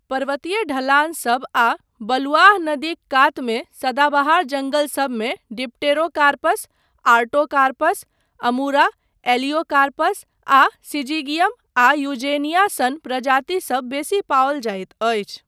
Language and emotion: Maithili, neutral